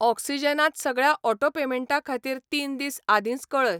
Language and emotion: Goan Konkani, neutral